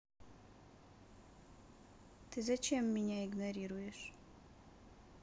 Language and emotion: Russian, sad